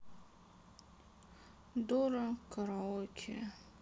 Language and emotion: Russian, sad